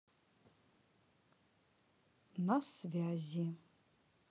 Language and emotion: Russian, neutral